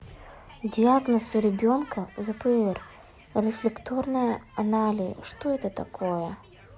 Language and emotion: Russian, neutral